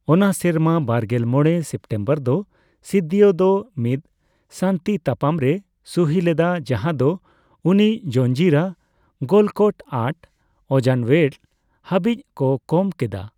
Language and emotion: Santali, neutral